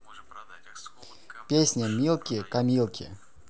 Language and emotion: Russian, neutral